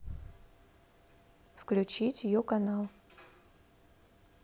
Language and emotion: Russian, neutral